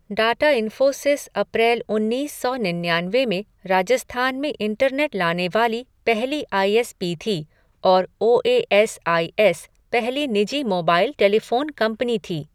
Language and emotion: Hindi, neutral